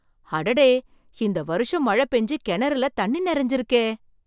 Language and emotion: Tamil, surprised